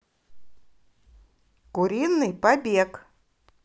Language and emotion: Russian, positive